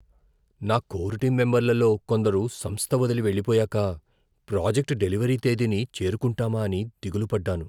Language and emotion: Telugu, fearful